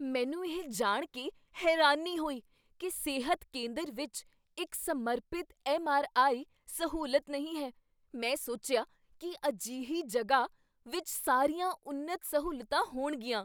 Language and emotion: Punjabi, surprised